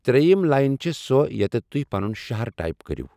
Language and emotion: Kashmiri, neutral